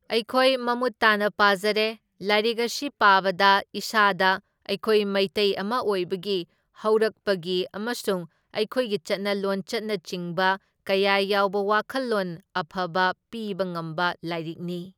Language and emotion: Manipuri, neutral